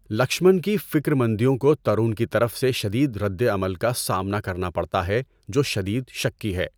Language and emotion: Urdu, neutral